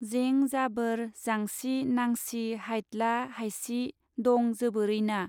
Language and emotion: Bodo, neutral